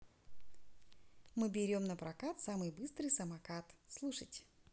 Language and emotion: Russian, positive